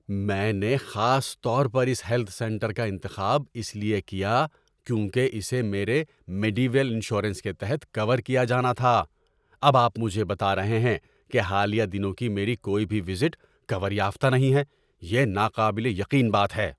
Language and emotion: Urdu, angry